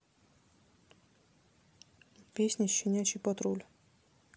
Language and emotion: Russian, neutral